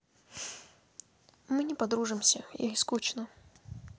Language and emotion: Russian, sad